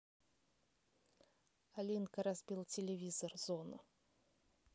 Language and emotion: Russian, neutral